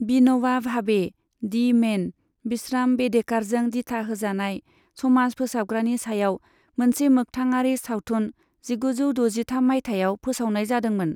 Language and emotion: Bodo, neutral